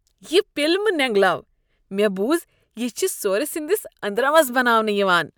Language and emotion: Kashmiri, disgusted